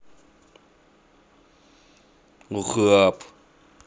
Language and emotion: Russian, neutral